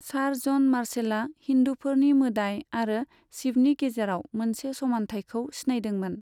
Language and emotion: Bodo, neutral